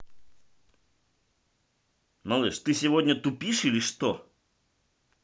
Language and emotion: Russian, angry